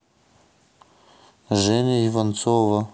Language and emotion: Russian, neutral